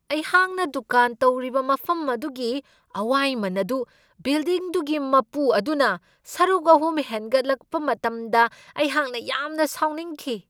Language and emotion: Manipuri, angry